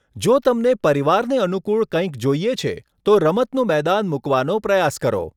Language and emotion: Gujarati, neutral